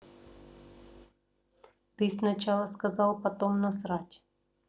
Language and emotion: Russian, neutral